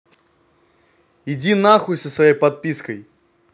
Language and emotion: Russian, angry